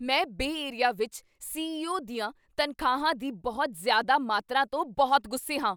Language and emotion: Punjabi, angry